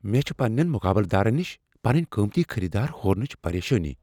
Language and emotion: Kashmiri, fearful